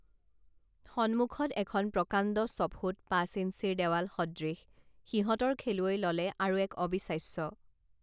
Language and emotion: Assamese, neutral